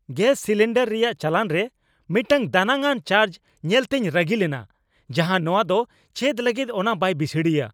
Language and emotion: Santali, angry